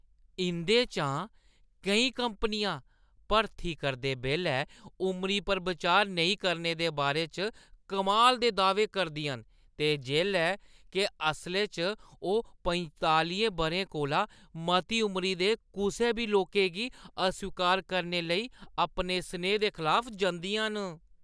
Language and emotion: Dogri, disgusted